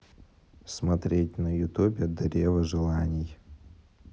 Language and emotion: Russian, neutral